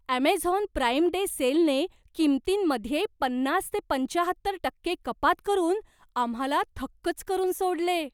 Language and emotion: Marathi, surprised